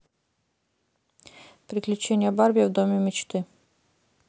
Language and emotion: Russian, neutral